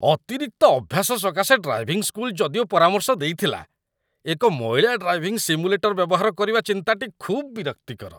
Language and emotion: Odia, disgusted